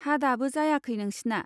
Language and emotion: Bodo, neutral